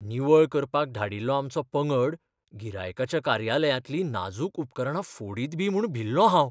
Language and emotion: Goan Konkani, fearful